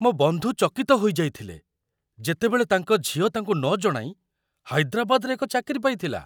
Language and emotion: Odia, surprised